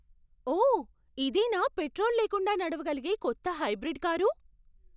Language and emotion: Telugu, surprised